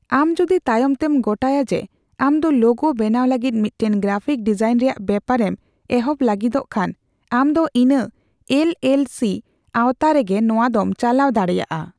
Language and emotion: Santali, neutral